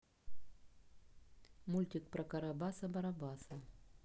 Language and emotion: Russian, neutral